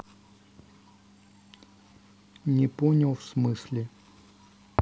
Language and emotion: Russian, neutral